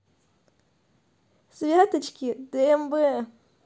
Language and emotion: Russian, neutral